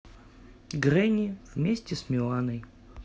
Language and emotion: Russian, neutral